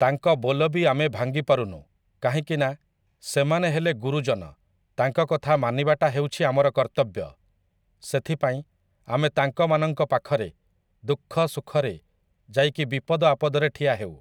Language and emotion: Odia, neutral